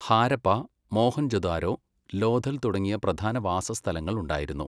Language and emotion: Malayalam, neutral